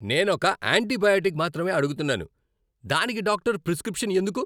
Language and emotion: Telugu, angry